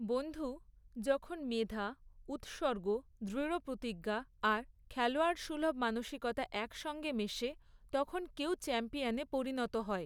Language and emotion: Bengali, neutral